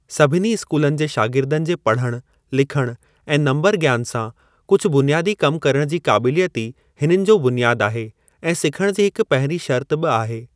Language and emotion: Sindhi, neutral